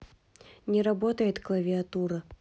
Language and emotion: Russian, neutral